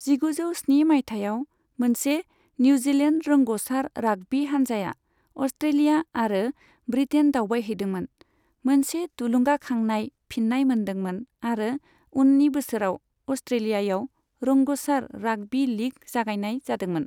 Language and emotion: Bodo, neutral